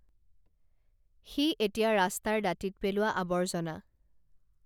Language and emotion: Assamese, neutral